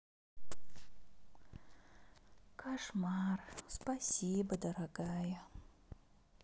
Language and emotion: Russian, sad